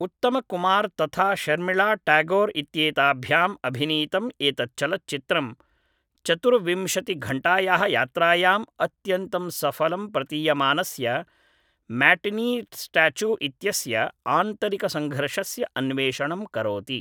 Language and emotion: Sanskrit, neutral